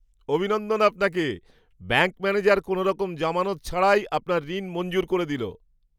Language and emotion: Bengali, surprised